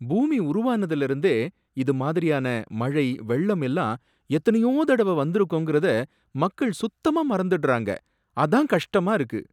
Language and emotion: Tamil, sad